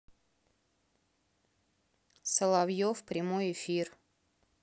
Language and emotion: Russian, neutral